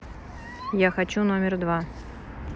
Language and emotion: Russian, neutral